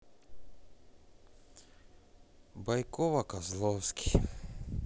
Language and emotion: Russian, sad